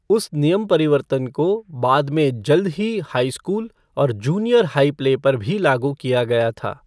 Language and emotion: Hindi, neutral